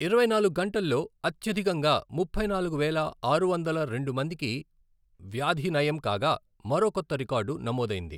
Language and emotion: Telugu, neutral